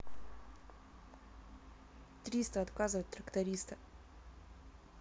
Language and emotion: Russian, neutral